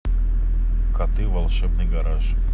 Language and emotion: Russian, neutral